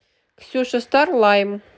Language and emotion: Russian, neutral